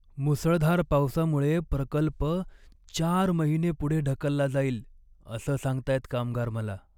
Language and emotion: Marathi, sad